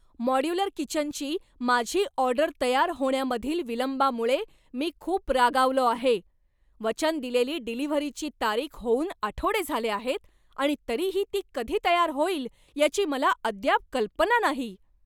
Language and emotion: Marathi, angry